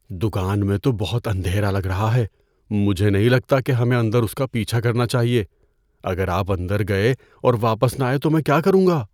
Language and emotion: Urdu, fearful